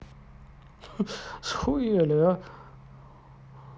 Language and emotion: Russian, positive